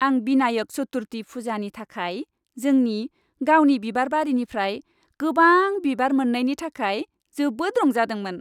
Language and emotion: Bodo, happy